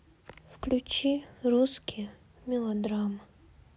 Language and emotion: Russian, sad